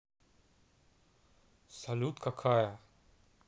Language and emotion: Russian, neutral